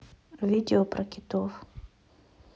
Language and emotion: Russian, neutral